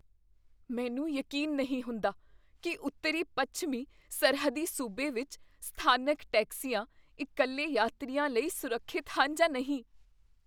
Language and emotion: Punjabi, fearful